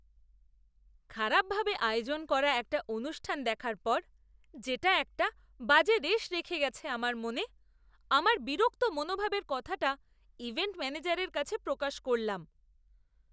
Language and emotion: Bengali, disgusted